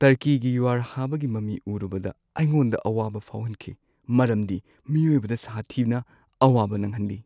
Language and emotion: Manipuri, sad